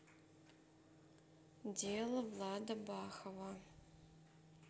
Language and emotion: Russian, neutral